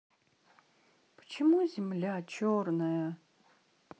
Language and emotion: Russian, sad